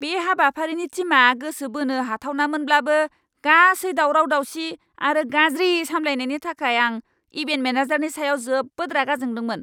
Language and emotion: Bodo, angry